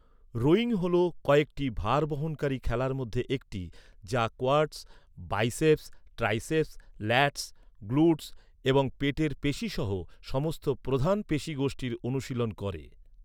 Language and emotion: Bengali, neutral